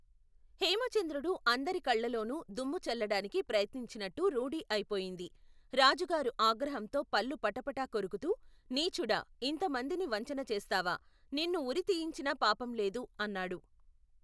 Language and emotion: Telugu, neutral